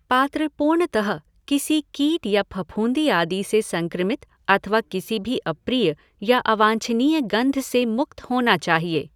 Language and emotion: Hindi, neutral